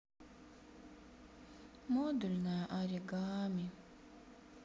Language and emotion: Russian, sad